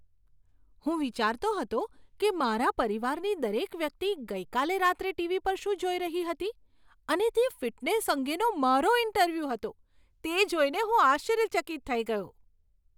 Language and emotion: Gujarati, surprised